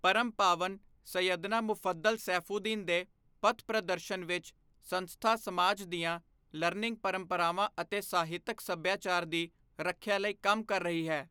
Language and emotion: Punjabi, neutral